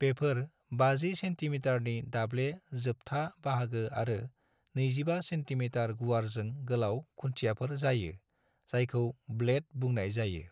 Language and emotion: Bodo, neutral